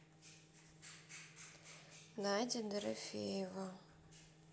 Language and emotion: Russian, sad